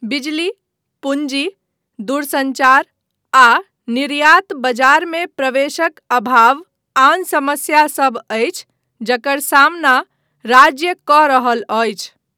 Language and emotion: Maithili, neutral